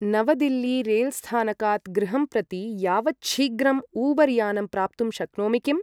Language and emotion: Sanskrit, neutral